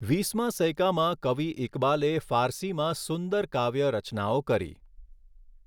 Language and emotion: Gujarati, neutral